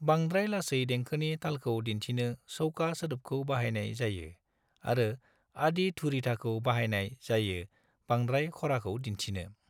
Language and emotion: Bodo, neutral